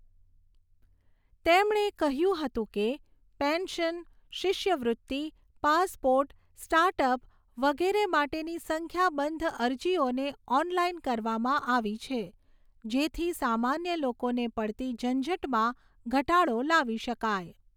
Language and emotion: Gujarati, neutral